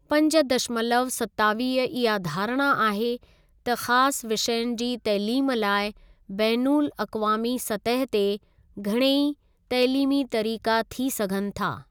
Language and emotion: Sindhi, neutral